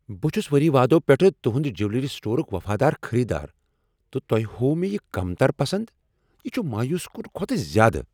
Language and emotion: Kashmiri, angry